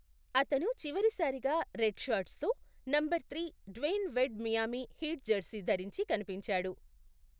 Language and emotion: Telugu, neutral